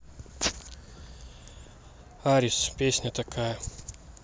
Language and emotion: Russian, neutral